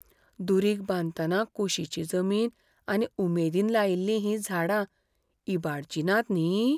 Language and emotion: Goan Konkani, fearful